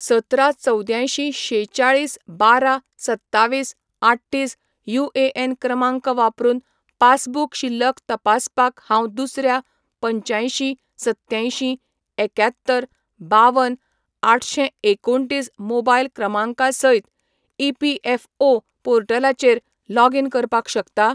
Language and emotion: Goan Konkani, neutral